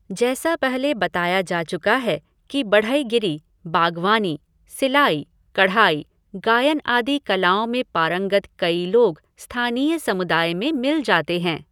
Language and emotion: Hindi, neutral